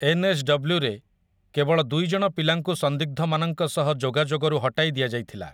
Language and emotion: Odia, neutral